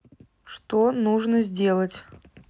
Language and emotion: Russian, neutral